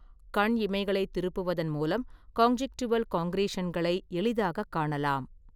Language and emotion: Tamil, neutral